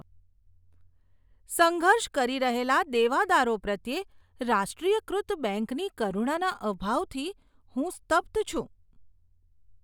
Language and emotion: Gujarati, disgusted